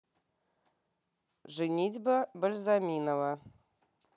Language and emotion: Russian, neutral